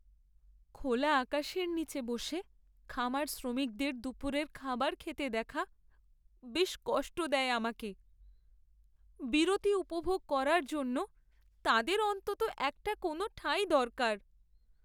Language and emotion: Bengali, sad